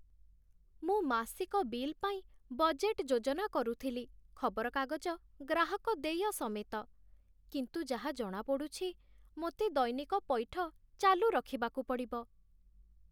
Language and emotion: Odia, sad